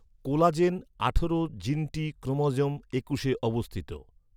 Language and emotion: Bengali, neutral